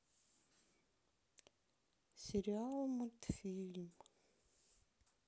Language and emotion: Russian, sad